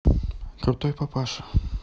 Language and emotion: Russian, neutral